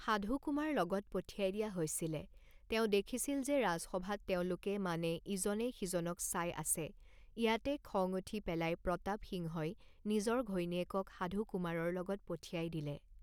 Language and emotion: Assamese, neutral